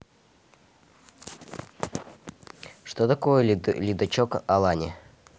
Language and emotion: Russian, neutral